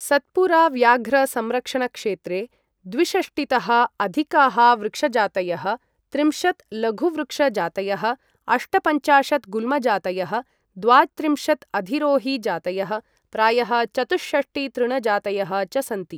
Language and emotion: Sanskrit, neutral